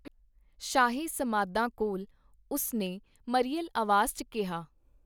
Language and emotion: Punjabi, neutral